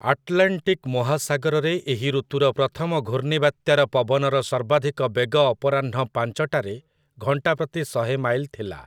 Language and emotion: Odia, neutral